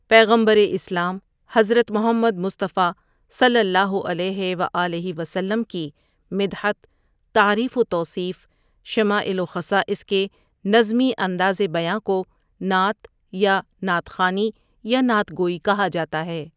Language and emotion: Urdu, neutral